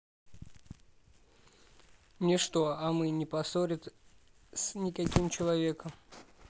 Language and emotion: Russian, neutral